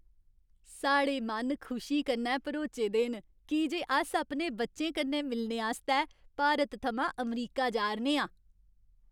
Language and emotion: Dogri, happy